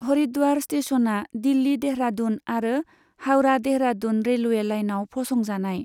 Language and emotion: Bodo, neutral